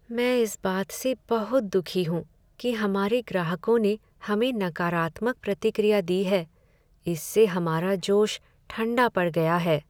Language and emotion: Hindi, sad